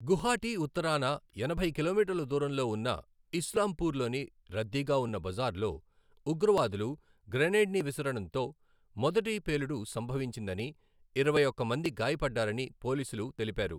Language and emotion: Telugu, neutral